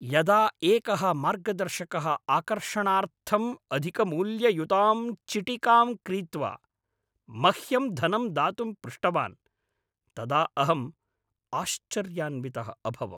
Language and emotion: Sanskrit, angry